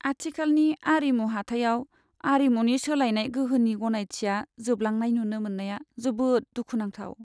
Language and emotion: Bodo, sad